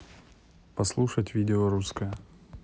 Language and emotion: Russian, neutral